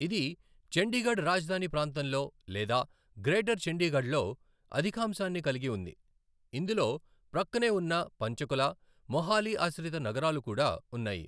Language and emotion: Telugu, neutral